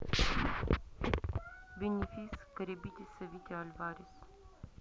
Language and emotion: Russian, neutral